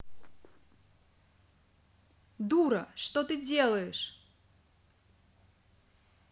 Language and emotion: Russian, angry